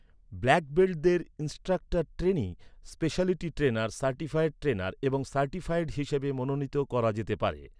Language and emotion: Bengali, neutral